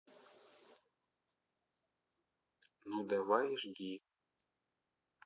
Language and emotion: Russian, neutral